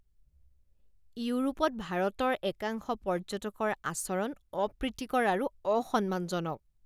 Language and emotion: Assamese, disgusted